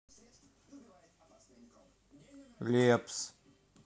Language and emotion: Russian, neutral